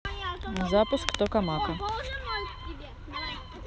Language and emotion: Russian, neutral